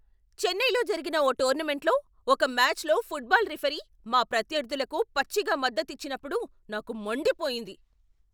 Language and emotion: Telugu, angry